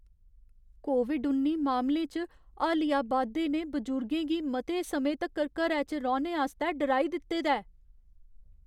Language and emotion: Dogri, fearful